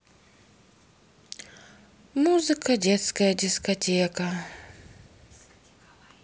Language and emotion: Russian, sad